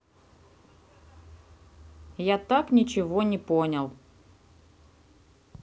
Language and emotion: Russian, neutral